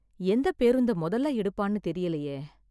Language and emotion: Tamil, sad